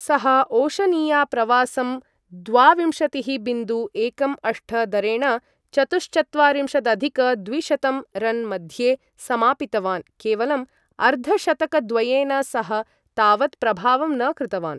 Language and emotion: Sanskrit, neutral